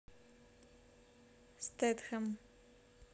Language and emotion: Russian, neutral